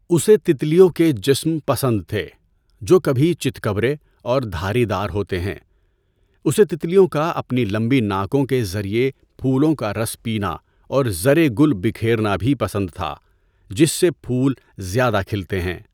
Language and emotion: Urdu, neutral